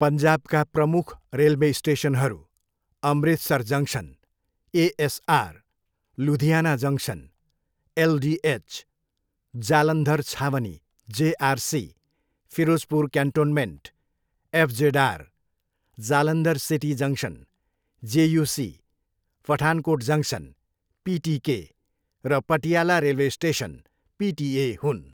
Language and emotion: Nepali, neutral